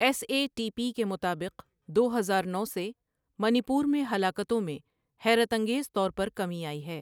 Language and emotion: Urdu, neutral